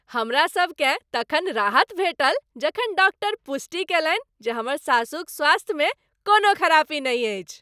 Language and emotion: Maithili, happy